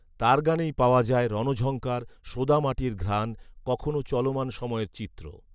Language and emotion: Bengali, neutral